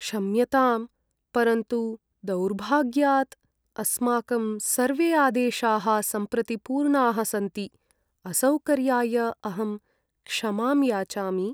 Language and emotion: Sanskrit, sad